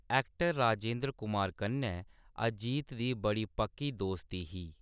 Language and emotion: Dogri, neutral